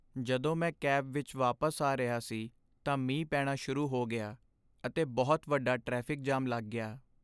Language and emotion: Punjabi, sad